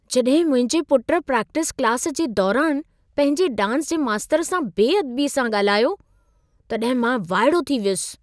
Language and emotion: Sindhi, surprised